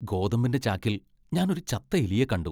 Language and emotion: Malayalam, disgusted